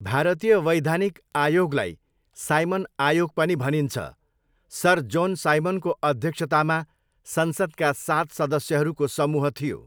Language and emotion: Nepali, neutral